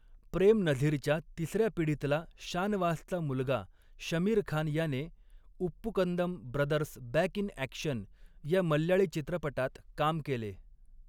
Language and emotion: Marathi, neutral